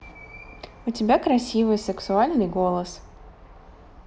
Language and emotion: Russian, positive